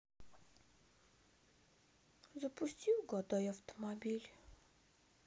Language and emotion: Russian, sad